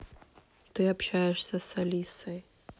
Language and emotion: Russian, neutral